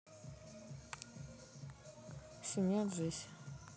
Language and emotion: Russian, neutral